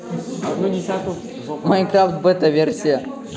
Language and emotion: Russian, positive